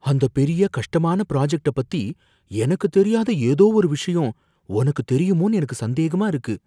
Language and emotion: Tamil, fearful